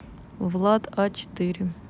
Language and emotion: Russian, neutral